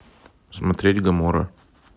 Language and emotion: Russian, neutral